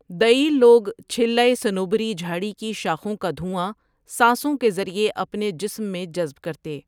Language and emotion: Urdu, neutral